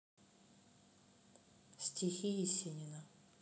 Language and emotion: Russian, neutral